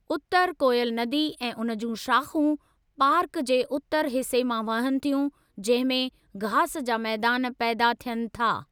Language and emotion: Sindhi, neutral